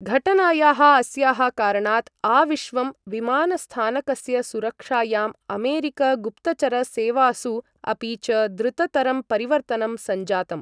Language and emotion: Sanskrit, neutral